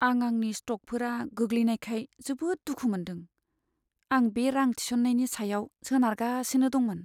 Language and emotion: Bodo, sad